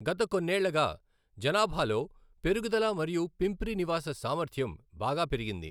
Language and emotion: Telugu, neutral